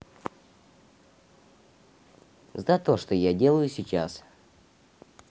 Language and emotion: Russian, neutral